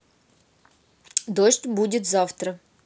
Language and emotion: Russian, neutral